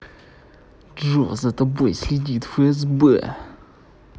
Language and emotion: Russian, angry